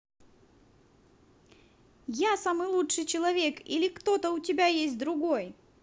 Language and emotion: Russian, positive